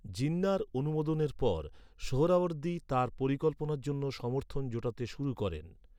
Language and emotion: Bengali, neutral